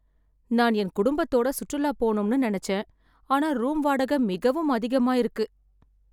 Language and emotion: Tamil, sad